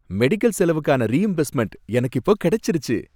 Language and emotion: Tamil, happy